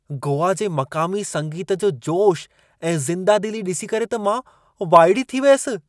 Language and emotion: Sindhi, surprised